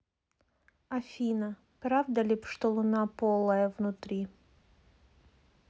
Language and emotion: Russian, neutral